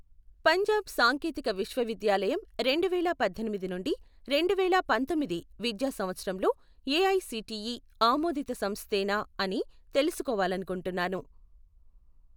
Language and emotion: Telugu, neutral